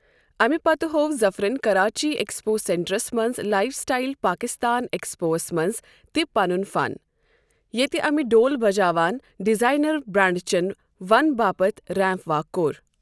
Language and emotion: Kashmiri, neutral